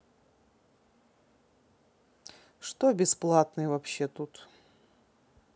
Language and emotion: Russian, neutral